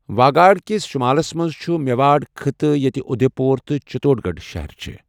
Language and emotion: Kashmiri, neutral